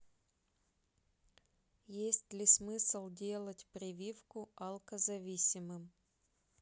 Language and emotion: Russian, neutral